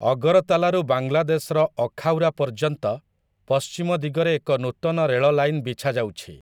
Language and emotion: Odia, neutral